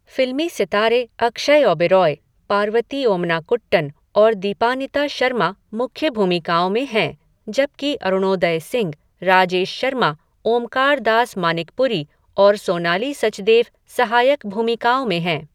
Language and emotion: Hindi, neutral